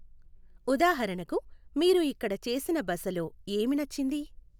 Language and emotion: Telugu, neutral